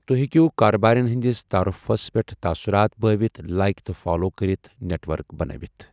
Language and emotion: Kashmiri, neutral